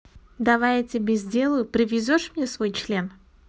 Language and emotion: Russian, neutral